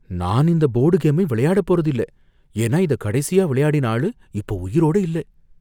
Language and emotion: Tamil, fearful